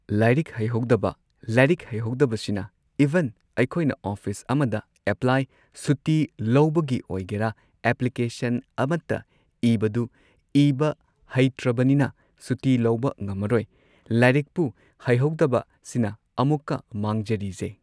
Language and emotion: Manipuri, neutral